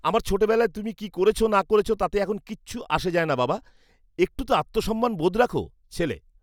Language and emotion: Bengali, disgusted